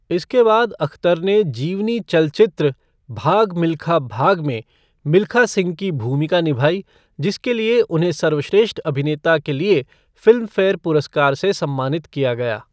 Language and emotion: Hindi, neutral